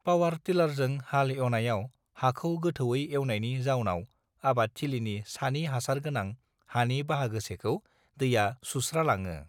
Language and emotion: Bodo, neutral